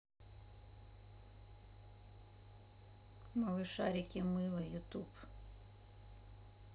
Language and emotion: Russian, neutral